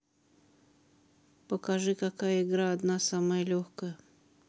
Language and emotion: Russian, neutral